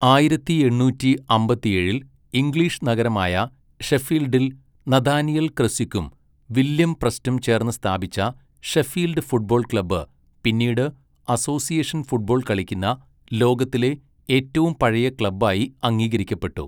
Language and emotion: Malayalam, neutral